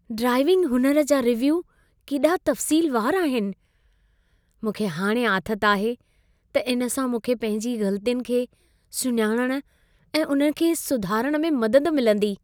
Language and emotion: Sindhi, happy